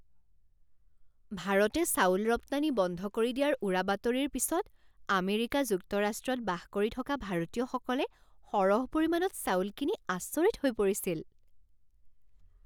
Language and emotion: Assamese, surprised